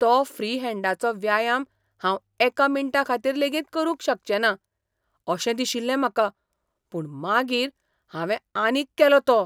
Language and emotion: Goan Konkani, surprised